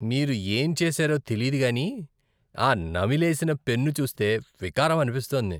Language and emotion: Telugu, disgusted